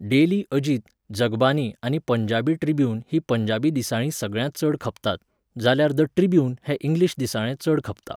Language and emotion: Goan Konkani, neutral